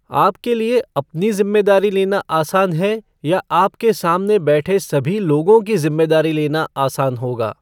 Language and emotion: Hindi, neutral